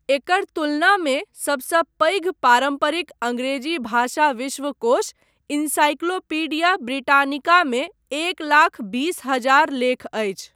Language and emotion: Maithili, neutral